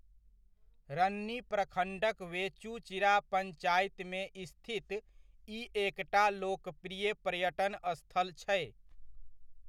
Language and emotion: Maithili, neutral